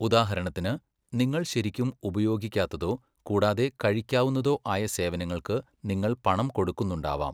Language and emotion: Malayalam, neutral